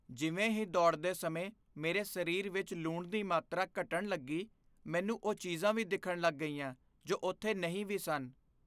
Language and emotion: Punjabi, fearful